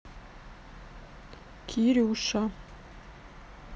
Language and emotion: Russian, neutral